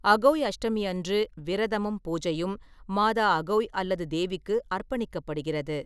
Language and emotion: Tamil, neutral